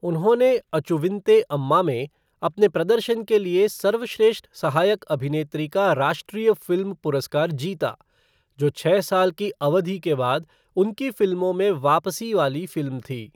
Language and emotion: Hindi, neutral